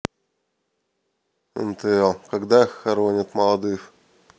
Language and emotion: Russian, neutral